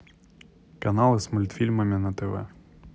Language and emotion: Russian, neutral